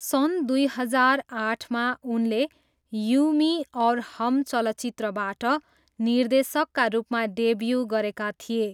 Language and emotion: Nepali, neutral